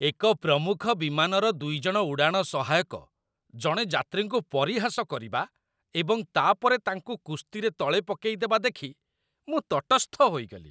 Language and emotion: Odia, disgusted